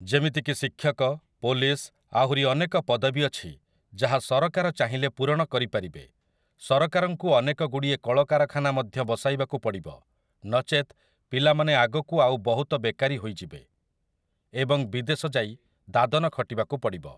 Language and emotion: Odia, neutral